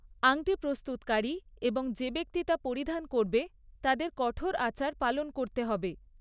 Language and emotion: Bengali, neutral